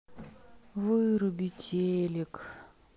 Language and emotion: Russian, sad